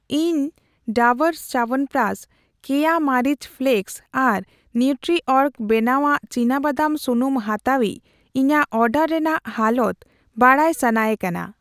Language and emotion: Santali, neutral